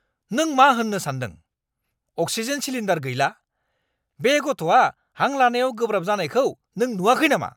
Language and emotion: Bodo, angry